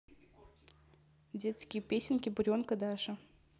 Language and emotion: Russian, neutral